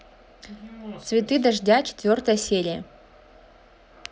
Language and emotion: Russian, neutral